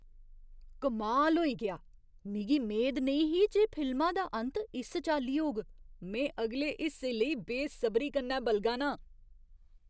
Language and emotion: Dogri, surprised